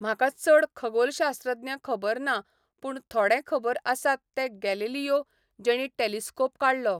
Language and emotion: Goan Konkani, neutral